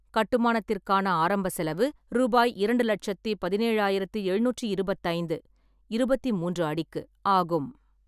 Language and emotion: Tamil, neutral